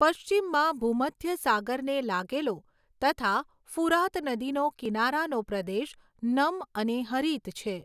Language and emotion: Gujarati, neutral